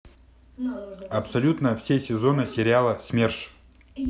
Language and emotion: Russian, neutral